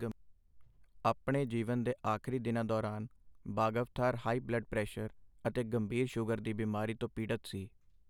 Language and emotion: Punjabi, neutral